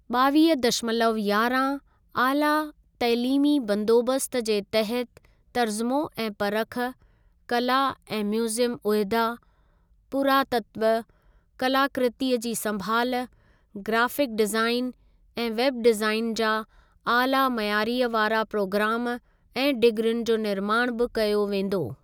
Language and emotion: Sindhi, neutral